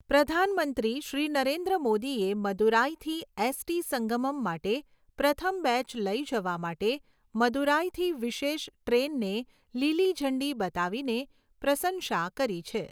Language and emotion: Gujarati, neutral